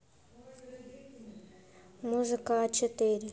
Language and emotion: Russian, neutral